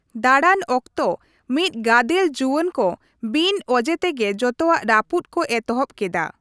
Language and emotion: Santali, neutral